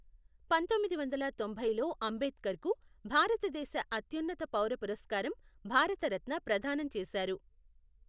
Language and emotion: Telugu, neutral